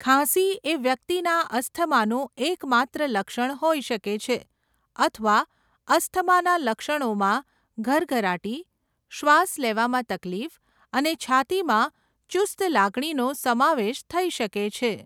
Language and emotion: Gujarati, neutral